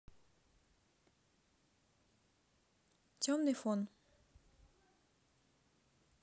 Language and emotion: Russian, neutral